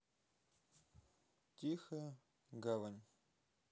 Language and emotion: Russian, neutral